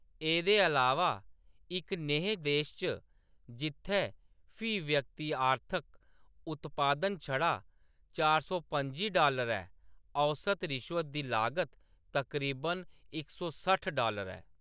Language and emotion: Dogri, neutral